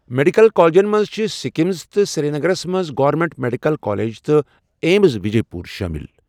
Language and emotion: Kashmiri, neutral